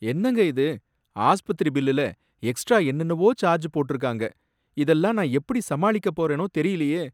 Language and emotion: Tamil, sad